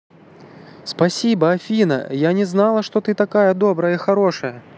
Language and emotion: Russian, positive